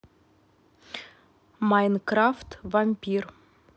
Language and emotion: Russian, neutral